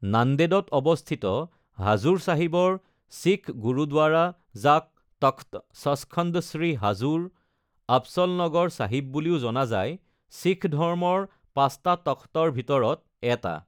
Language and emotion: Assamese, neutral